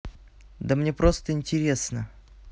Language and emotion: Russian, neutral